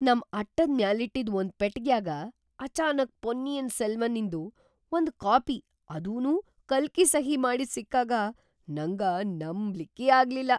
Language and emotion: Kannada, surprised